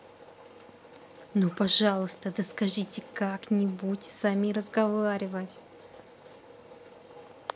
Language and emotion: Russian, angry